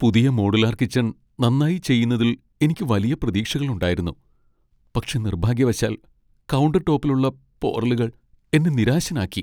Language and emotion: Malayalam, sad